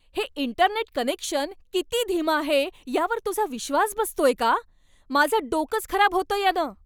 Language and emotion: Marathi, angry